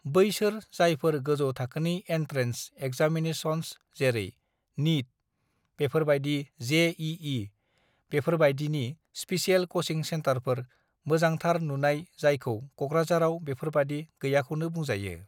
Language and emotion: Bodo, neutral